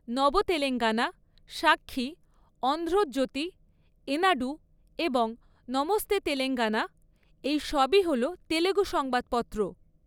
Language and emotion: Bengali, neutral